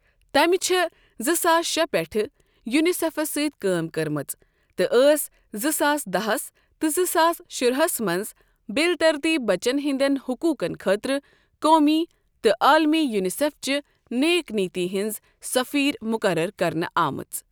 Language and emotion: Kashmiri, neutral